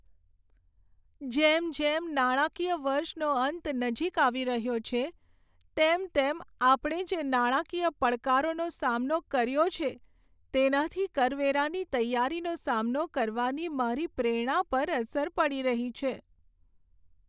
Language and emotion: Gujarati, sad